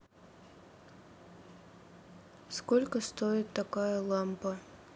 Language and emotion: Russian, neutral